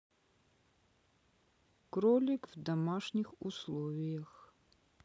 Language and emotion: Russian, neutral